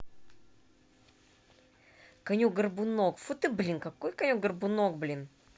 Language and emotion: Russian, angry